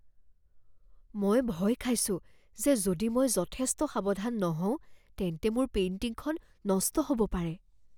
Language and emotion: Assamese, fearful